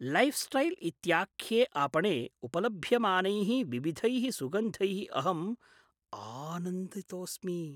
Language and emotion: Sanskrit, surprised